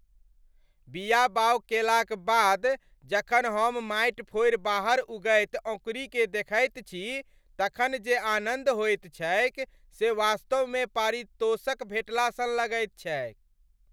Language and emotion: Maithili, happy